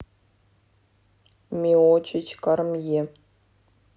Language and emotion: Russian, neutral